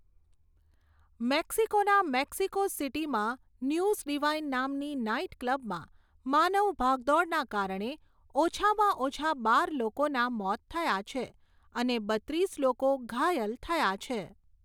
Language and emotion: Gujarati, neutral